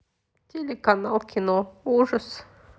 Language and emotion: Russian, sad